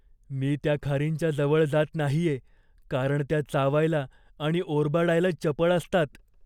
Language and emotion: Marathi, fearful